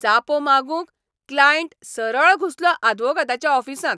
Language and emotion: Goan Konkani, angry